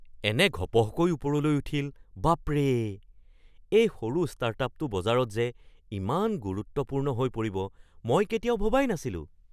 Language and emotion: Assamese, surprised